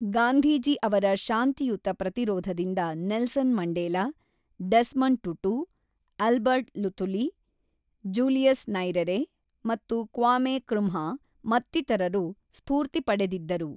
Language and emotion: Kannada, neutral